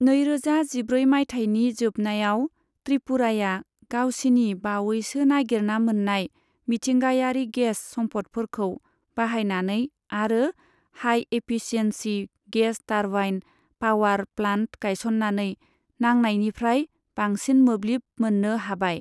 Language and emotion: Bodo, neutral